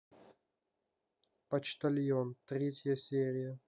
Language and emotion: Russian, neutral